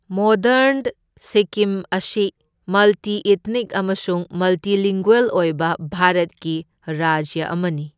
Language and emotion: Manipuri, neutral